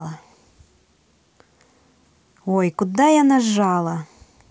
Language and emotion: Russian, angry